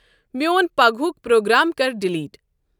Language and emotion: Kashmiri, neutral